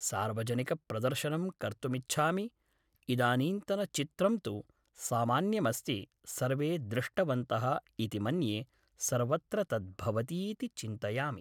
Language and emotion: Sanskrit, neutral